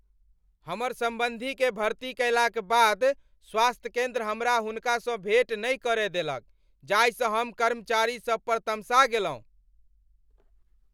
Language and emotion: Maithili, angry